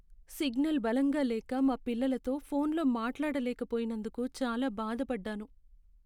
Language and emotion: Telugu, sad